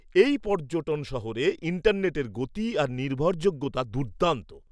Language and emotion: Bengali, surprised